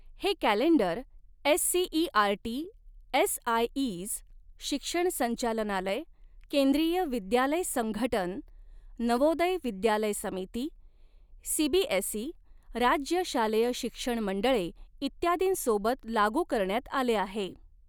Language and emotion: Marathi, neutral